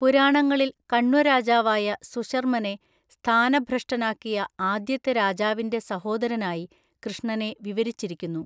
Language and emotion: Malayalam, neutral